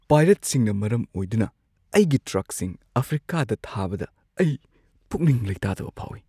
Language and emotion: Manipuri, fearful